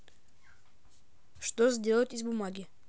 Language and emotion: Russian, neutral